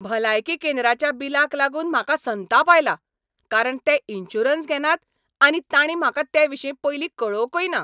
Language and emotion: Goan Konkani, angry